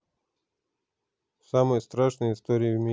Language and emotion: Russian, neutral